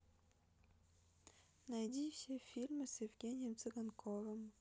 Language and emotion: Russian, neutral